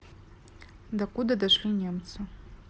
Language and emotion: Russian, neutral